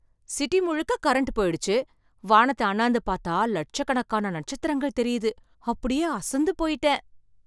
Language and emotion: Tamil, surprised